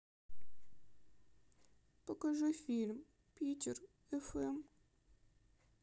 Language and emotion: Russian, sad